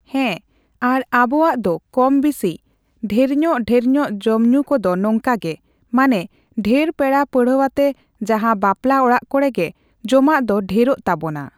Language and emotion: Santali, neutral